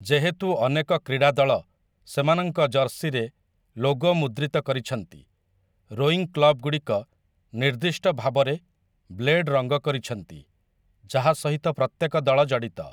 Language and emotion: Odia, neutral